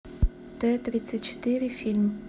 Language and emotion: Russian, neutral